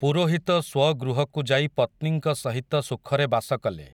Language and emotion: Odia, neutral